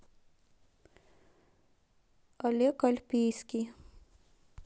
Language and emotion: Russian, neutral